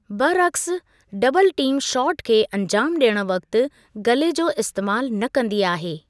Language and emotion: Sindhi, neutral